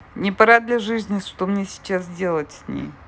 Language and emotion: Russian, neutral